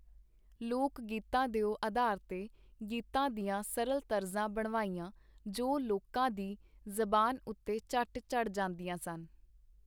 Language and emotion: Punjabi, neutral